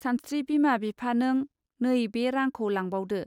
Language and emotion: Bodo, neutral